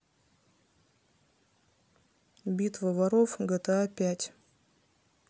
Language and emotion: Russian, neutral